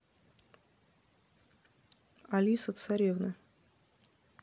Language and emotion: Russian, neutral